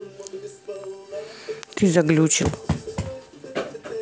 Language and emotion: Russian, neutral